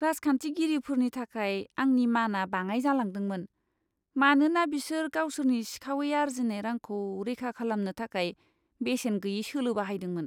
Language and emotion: Bodo, disgusted